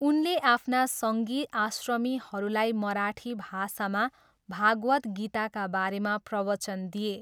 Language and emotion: Nepali, neutral